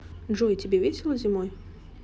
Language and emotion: Russian, neutral